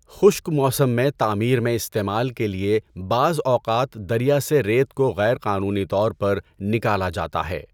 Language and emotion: Urdu, neutral